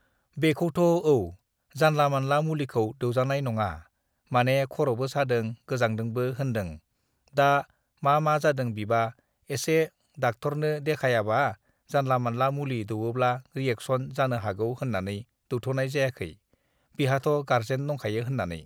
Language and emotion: Bodo, neutral